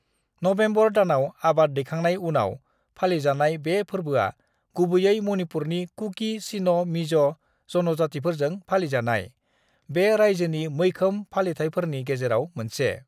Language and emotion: Bodo, neutral